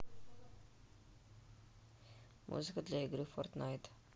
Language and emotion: Russian, neutral